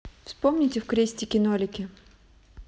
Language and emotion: Russian, neutral